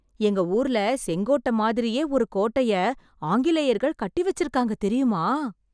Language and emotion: Tamil, surprised